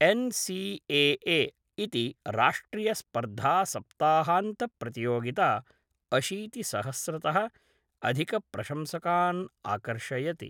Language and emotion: Sanskrit, neutral